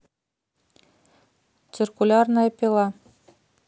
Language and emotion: Russian, neutral